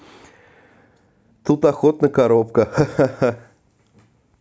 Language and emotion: Russian, positive